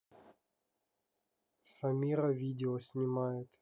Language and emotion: Russian, neutral